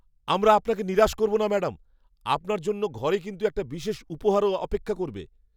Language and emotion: Bengali, happy